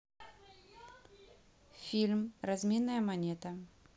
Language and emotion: Russian, neutral